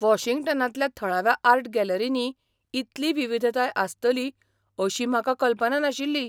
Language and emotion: Goan Konkani, surprised